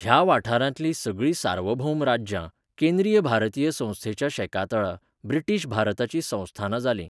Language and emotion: Goan Konkani, neutral